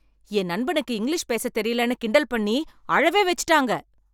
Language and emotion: Tamil, angry